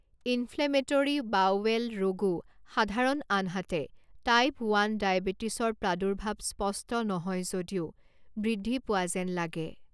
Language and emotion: Assamese, neutral